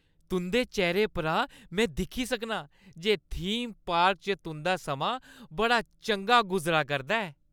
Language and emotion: Dogri, happy